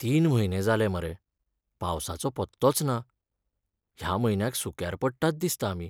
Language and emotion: Goan Konkani, sad